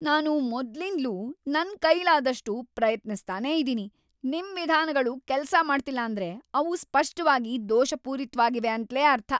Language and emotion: Kannada, angry